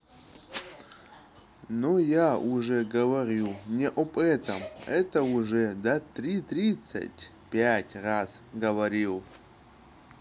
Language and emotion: Russian, neutral